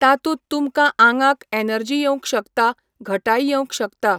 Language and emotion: Goan Konkani, neutral